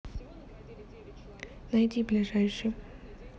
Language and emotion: Russian, neutral